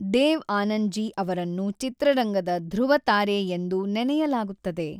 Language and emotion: Kannada, neutral